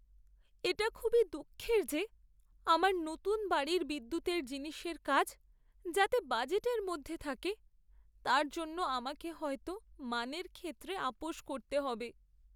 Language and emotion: Bengali, sad